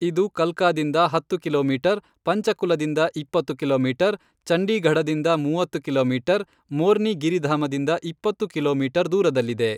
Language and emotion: Kannada, neutral